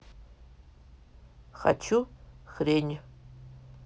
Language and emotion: Russian, neutral